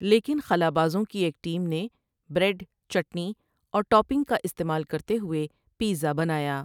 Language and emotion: Urdu, neutral